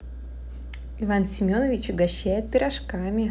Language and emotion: Russian, positive